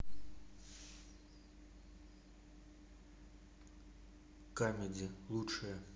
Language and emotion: Russian, neutral